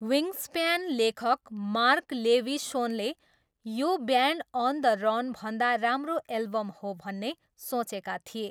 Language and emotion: Nepali, neutral